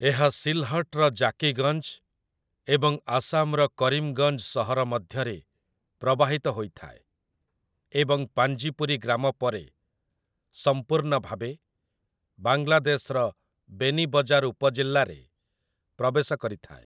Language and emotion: Odia, neutral